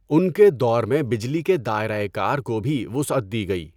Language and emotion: Urdu, neutral